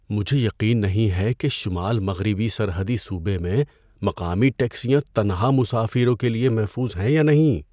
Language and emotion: Urdu, fearful